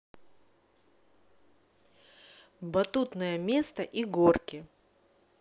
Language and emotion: Russian, neutral